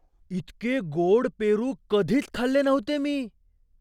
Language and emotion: Marathi, surprised